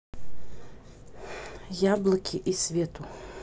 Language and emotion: Russian, neutral